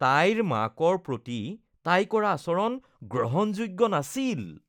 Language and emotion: Assamese, disgusted